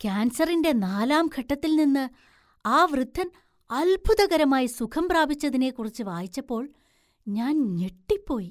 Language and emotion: Malayalam, surprised